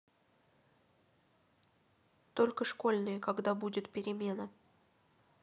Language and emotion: Russian, neutral